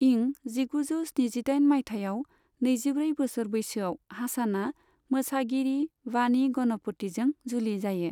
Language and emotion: Bodo, neutral